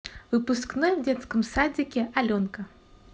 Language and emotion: Russian, positive